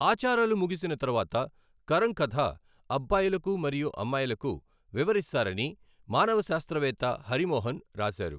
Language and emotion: Telugu, neutral